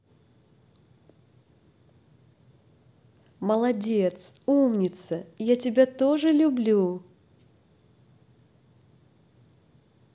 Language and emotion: Russian, positive